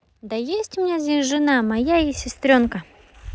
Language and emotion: Russian, neutral